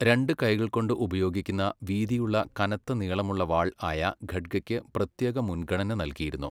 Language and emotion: Malayalam, neutral